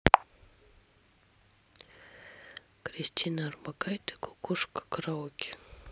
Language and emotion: Russian, neutral